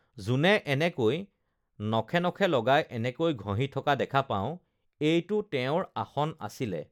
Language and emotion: Assamese, neutral